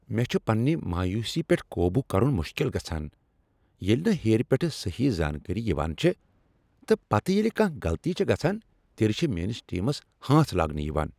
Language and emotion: Kashmiri, angry